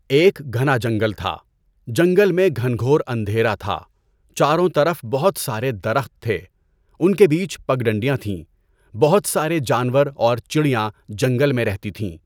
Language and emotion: Urdu, neutral